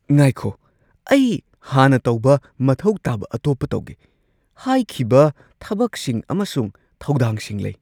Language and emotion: Manipuri, surprised